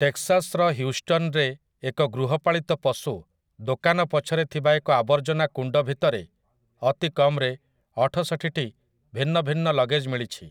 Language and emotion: Odia, neutral